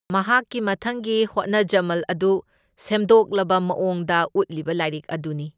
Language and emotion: Manipuri, neutral